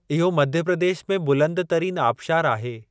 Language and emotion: Sindhi, neutral